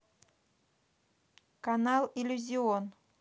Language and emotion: Russian, neutral